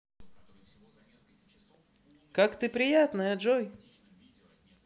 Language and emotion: Russian, positive